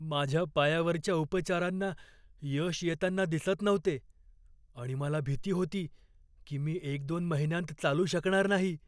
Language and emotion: Marathi, fearful